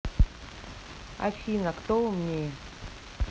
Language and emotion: Russian, neutral